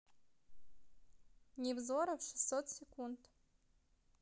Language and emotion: Russian, neutral